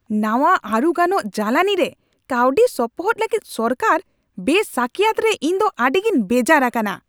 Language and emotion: Santali, angry